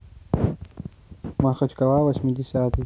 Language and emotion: Russian, neutral